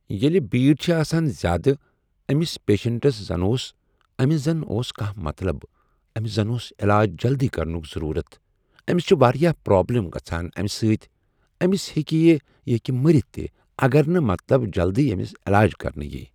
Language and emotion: Kashmiri, neutral